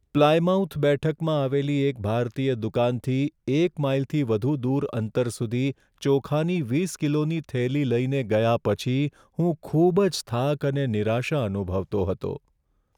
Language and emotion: Gujarati, sad